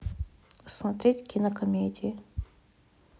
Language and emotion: Russian, neutral